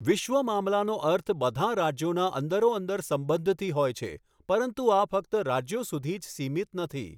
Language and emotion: Gujarati, neutral